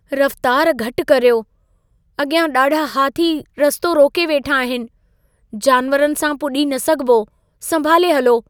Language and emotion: Sindhi, fearful